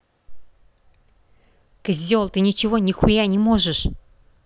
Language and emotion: Russian, angry